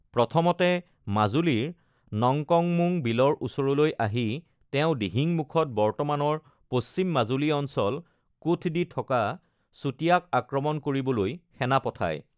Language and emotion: Assamese, neutral